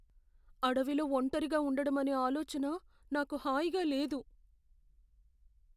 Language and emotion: Telugu, fearful